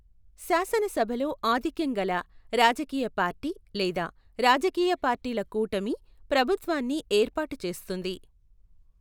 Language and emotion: Telugu, neutral